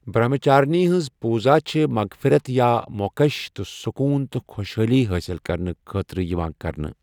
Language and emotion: Kashmiri, neutral